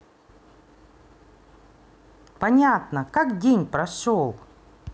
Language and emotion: Russian, positive